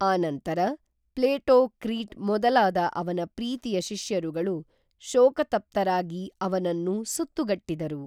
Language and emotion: Kannada, neutral